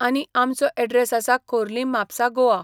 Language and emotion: Goan Konkani, neutral